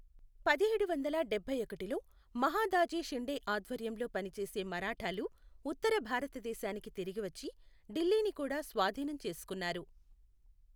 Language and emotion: Telugu, neutral